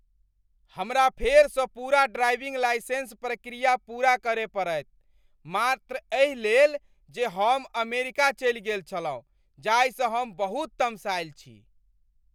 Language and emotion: Maithili, angry